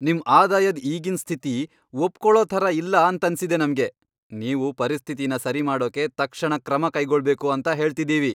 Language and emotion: Kannada, angry